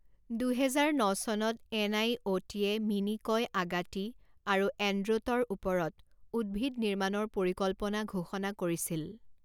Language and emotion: Assamese, neutral